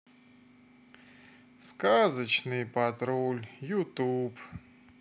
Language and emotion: Russian, sad